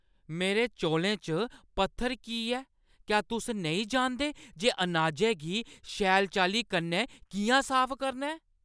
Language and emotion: Dogri, angry